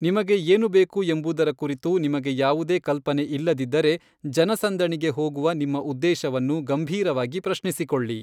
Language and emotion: Kannada, neutral